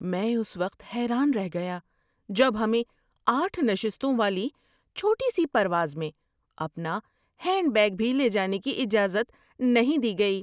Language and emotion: Urdu, surprised